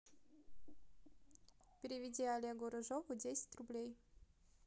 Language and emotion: Russian, neutral